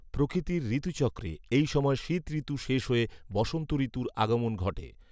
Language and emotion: Bengali, neutral